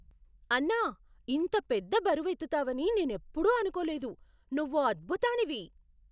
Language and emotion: Telugu, surprised